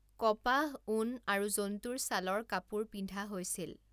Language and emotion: Assamese, neutral